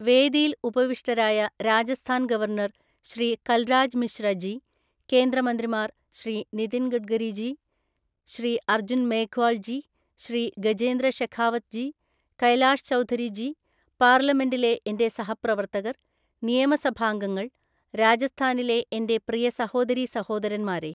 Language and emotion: Malayalam, neutral